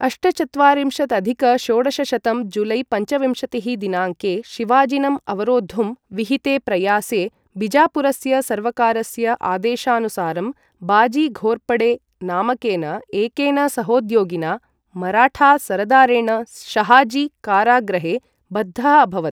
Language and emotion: Sanskrit, neutral